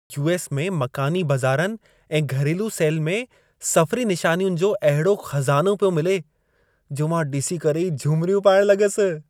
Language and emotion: Sindhi, happy